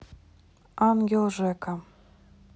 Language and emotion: Russian, neutral